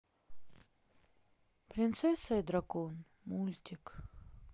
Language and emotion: Russian, sad